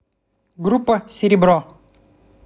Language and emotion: Russian, neutral